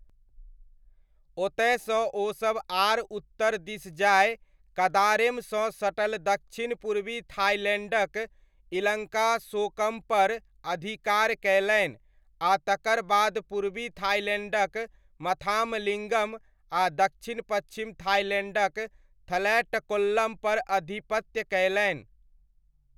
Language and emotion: Maithili, neutral